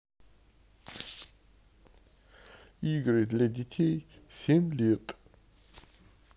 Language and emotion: Russian, neutral